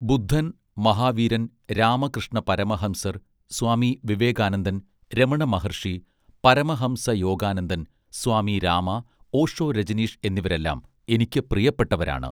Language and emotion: Malayalam, neutral